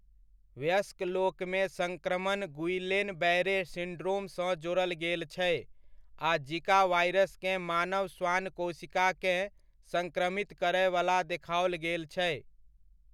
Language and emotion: Maithili, neutral